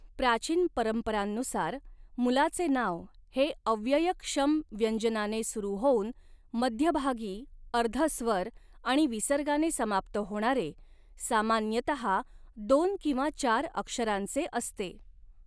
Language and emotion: Marathi, neutral